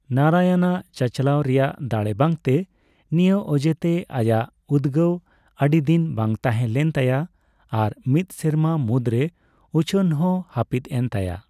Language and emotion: Santali, neutral